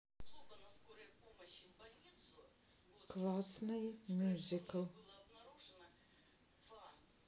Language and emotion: Russian, neutral